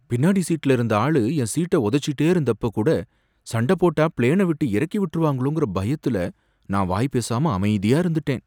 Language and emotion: Tamil, fearful